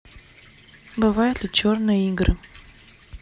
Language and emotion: Russian, neutral